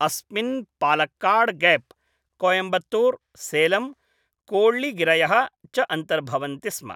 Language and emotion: Sanskrit, neutral